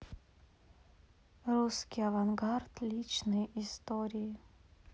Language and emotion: Russian, neutral